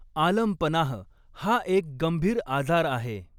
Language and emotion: Marathi, neutral